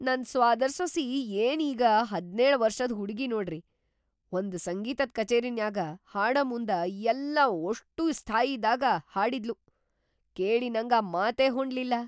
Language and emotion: Kannada, surprised